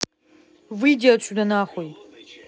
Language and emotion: Russian, angry